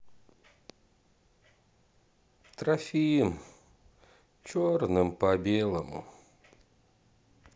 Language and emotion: Russian, sad